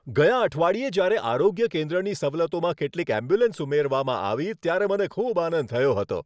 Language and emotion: Gujarati, happy